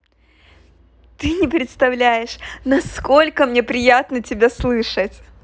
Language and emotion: Russian, positive